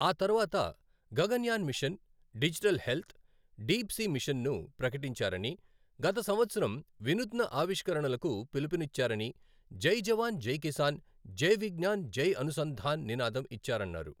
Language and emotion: Telugu, neutral